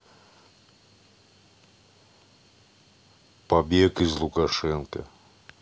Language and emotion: Russian, neutral